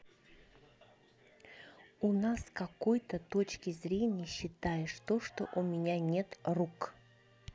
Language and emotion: Russian, neutral